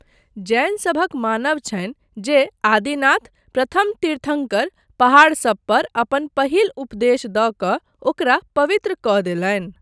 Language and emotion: Maithili, neutral